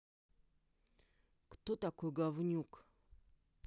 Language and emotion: Russian, angry